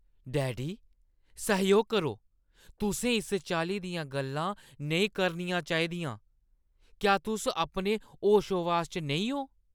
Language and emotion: Dogri, angry